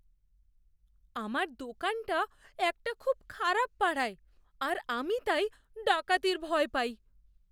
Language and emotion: Bengali, fearful